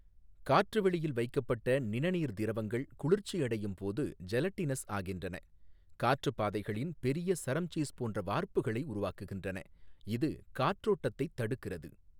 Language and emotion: Tamil, neutral